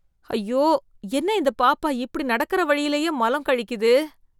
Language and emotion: Tamil, disgusted